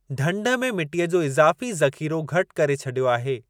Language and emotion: Sindhi, neutral